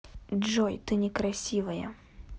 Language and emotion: Russian, angry